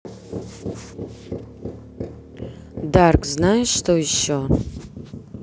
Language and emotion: Russian, neutral